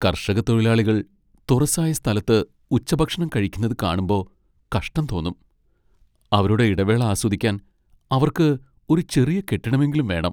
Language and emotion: Malayalam, sad